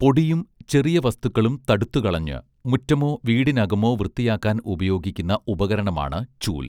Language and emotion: Malayalam, neutral